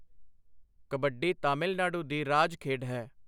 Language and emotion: Punjabi, neutral